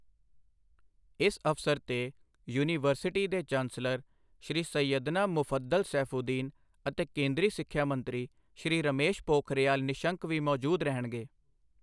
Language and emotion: Punjabi, neutral